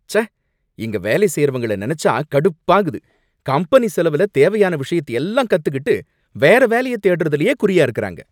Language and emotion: Tamil, angry